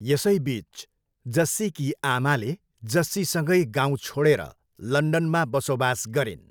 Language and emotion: Nepali, neutral